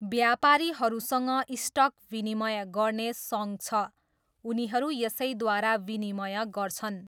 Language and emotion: Nepali, neutral